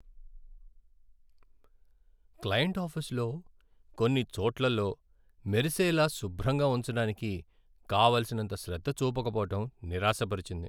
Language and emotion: Telugu, sad